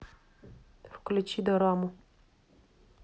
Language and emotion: Russian, neutral